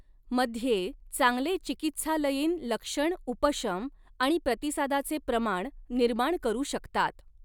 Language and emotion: Marathi, neutral